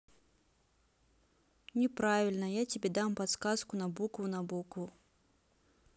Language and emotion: Russian, neutral